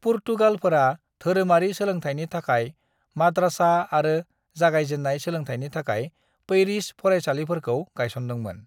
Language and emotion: Bodo, neutral